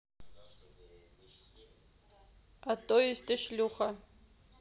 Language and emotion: Russian, neutral